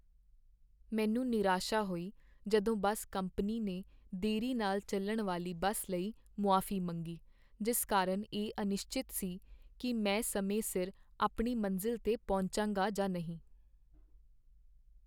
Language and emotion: Punjabi, sad